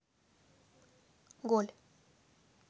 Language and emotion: Russian, neutral